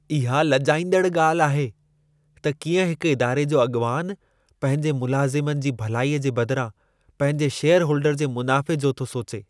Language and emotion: Sindhi, disgusted